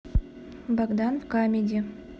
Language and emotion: Russian, neutral